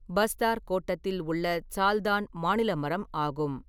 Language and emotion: Tamil, neutral